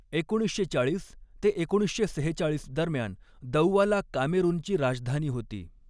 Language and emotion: Marathi, neutral